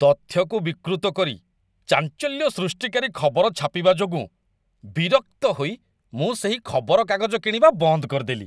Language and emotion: Odia, disgusted